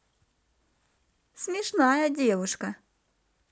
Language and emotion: Russian, positive